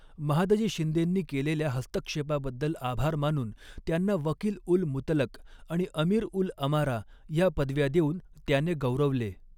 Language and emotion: Marathi, neutral